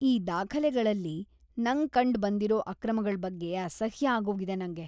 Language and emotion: Kannada, disgusted